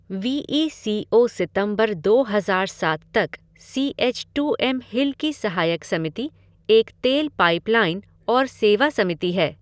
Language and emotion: Hindi, neutral